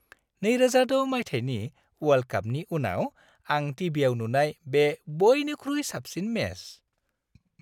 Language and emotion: Bodo, happy